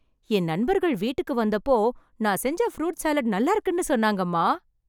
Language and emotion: Tamil, happy